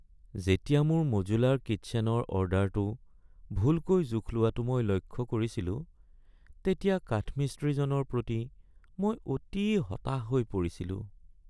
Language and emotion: Assamese, sad